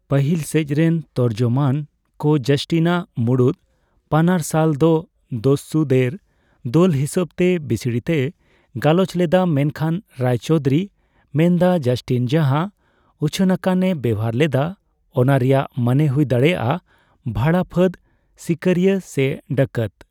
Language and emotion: Santali, neutral